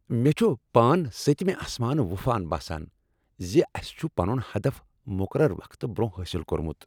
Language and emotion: Kashmiri, happy